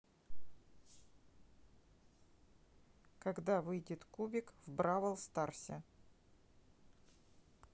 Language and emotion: Russian, neutral